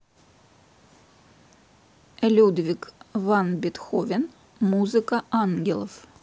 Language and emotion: Russian, neutral